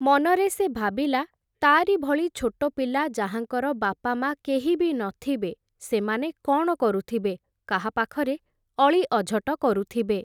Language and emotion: Odia, neutral